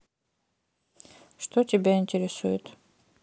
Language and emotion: Russian, neutral